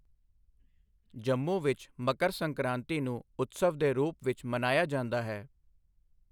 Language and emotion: Punjabi, neutral